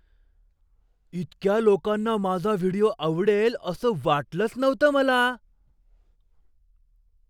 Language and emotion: Marathi, surprised